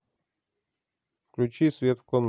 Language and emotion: Russian, neutral